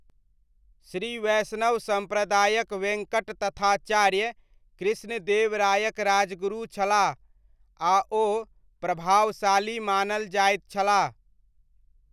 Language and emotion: Maithili, neutral